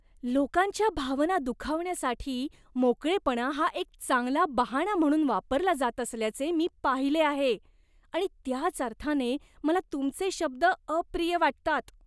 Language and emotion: Marathi, disgusted